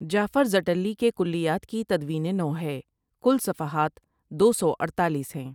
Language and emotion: Urdu, neutral